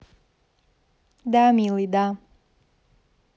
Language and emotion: Russian, positive